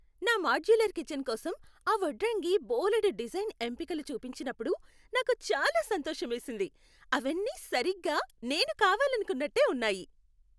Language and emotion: Telugu, happy